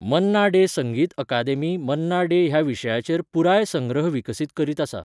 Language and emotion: Goan Konkani, neutral